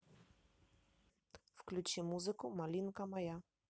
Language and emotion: Russian, neutral